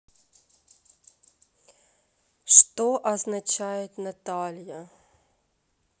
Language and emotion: Russian, neutral